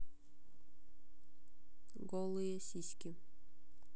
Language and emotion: Russian, neutral